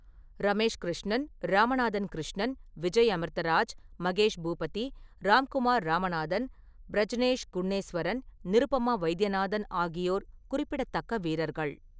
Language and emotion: Tamil, neutral